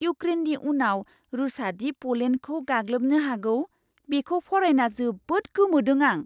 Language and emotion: Bodo, surprised